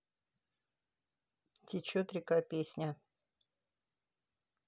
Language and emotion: Russian, neutral